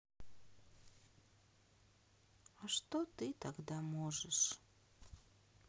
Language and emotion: Russian, sad